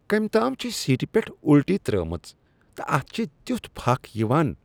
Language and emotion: Kashmiri, disgusted